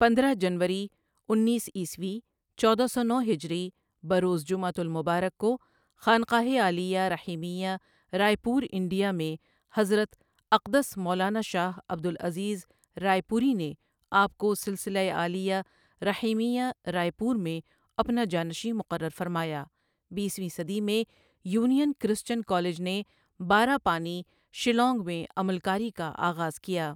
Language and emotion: Urdu, neutral